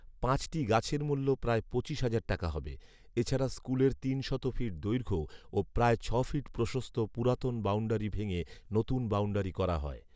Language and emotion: Bengali, neutral